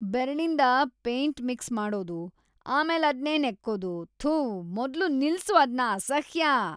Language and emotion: Kannada, disgusted